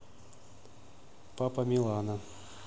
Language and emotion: Russian, neutral